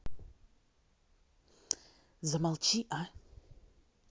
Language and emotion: Russian, angry